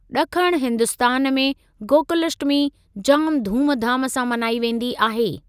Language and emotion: Sindhi, neutral